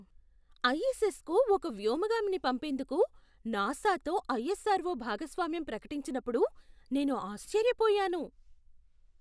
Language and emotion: Telugu, surprised